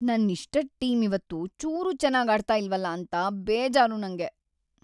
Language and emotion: Kannada, sad